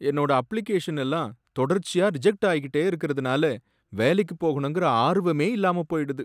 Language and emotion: Tamil, sad